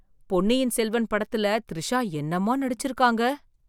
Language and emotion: Tamil, surprised